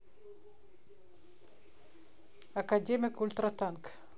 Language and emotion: Russian, neutral